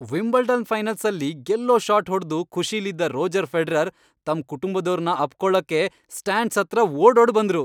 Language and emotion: Kannada, happy